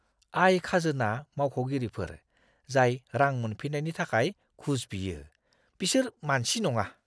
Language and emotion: Bodo, disgusted